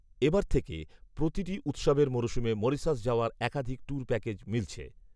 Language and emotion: Bengali, neutral